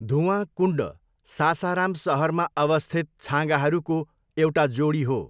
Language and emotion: Nepali, neutral